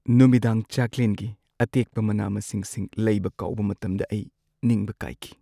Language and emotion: Manipuri, sad